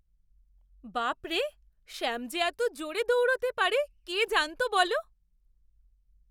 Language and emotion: Bengali, surprised